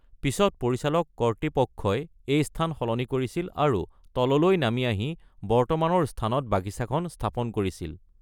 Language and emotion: Assamese, neutral